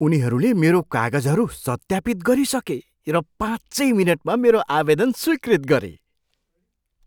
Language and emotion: Nepali, surprised